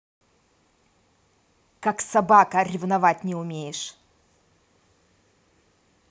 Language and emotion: Russian, angry